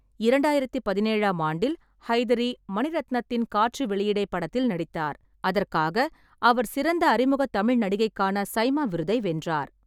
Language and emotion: Tamil, neutral